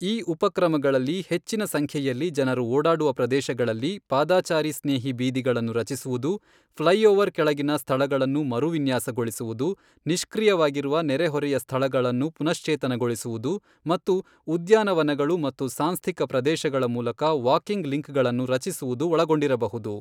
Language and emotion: Kannada, neutral